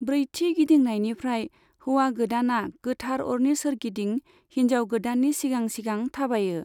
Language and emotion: Bodo, neutral